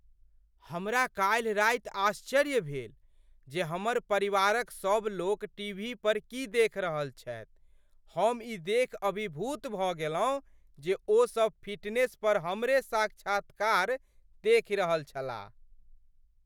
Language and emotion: Maithili, surprised